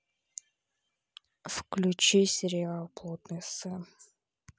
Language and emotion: Russian, neutral